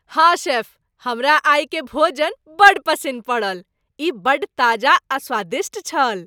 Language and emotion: Maithili, happy